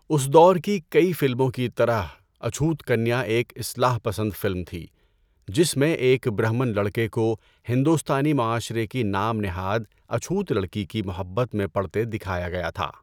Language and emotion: Urdu, neutral